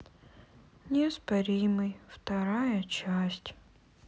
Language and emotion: Russian, sad